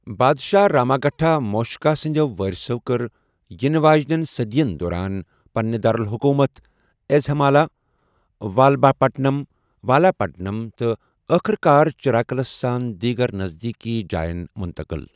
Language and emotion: Kashmiri, neutral